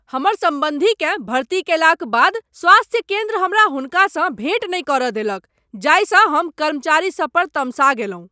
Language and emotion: Maithili, angry